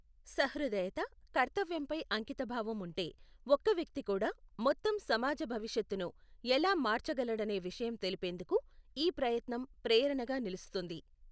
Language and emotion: Telugu, neutral